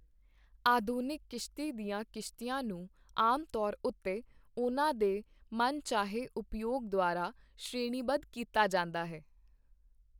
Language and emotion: Punjabi, neutral